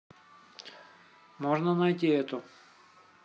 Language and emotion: Russian, neutral